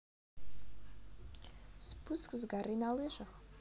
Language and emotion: Russian, neutral